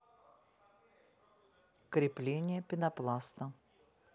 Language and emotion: Russian, neutral